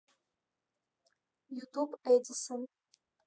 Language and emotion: Russian, neutral